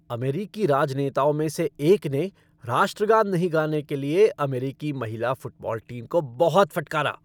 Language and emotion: Hindi, angry